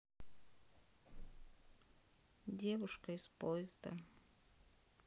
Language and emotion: Russian, neutral